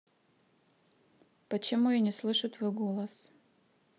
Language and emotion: Russian, neutral